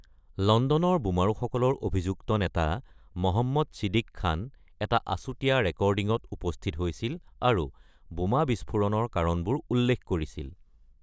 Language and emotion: Assamese, neutral